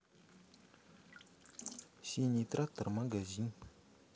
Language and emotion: Russian, neutral